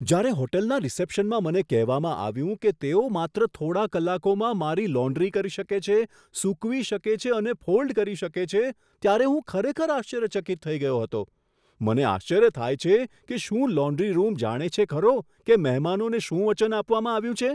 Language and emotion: Gujarati, surprised